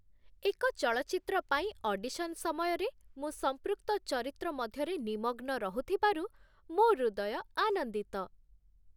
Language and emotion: Odia, happy